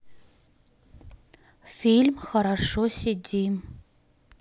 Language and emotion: Russian, neutral